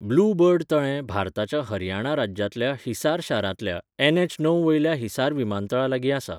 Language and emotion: Goan Konkani, neutral